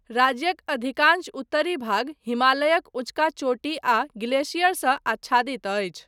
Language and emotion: Maithili, neutral